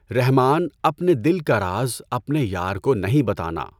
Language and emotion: Urdu, neutral